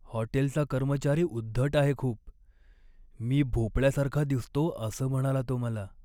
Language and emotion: Marathi, sad